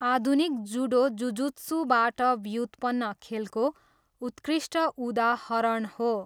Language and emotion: Nepali, neutral